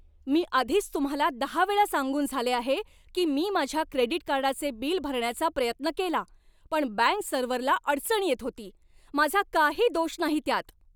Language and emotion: Marathi, angry